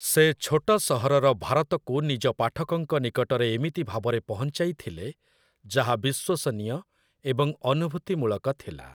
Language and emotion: Odia, neutral